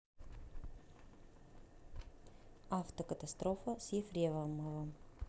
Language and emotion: Russian, neutral